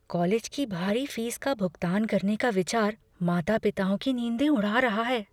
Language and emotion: Hindi, fearful